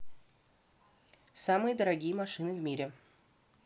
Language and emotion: Russian, neutral